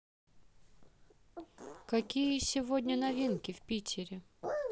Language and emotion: Russian, neutral